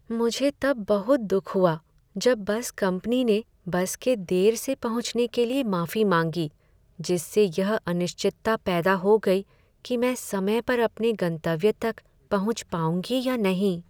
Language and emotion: Hindi, sad